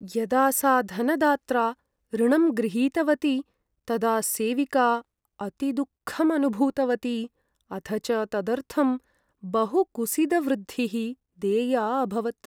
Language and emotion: Sanskrit, sad